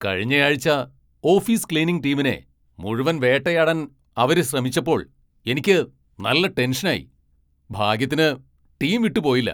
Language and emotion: Malayalam, angry